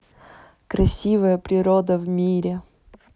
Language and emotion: Russian, positive